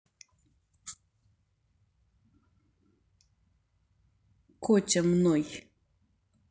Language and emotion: Russian, neutral